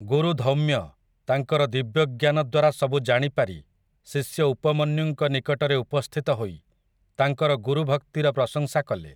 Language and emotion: Odia, neutral